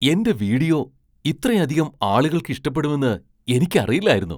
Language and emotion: Malayalam, surprised